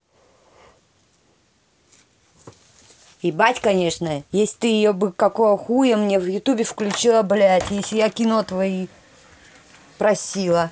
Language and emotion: Russian, angry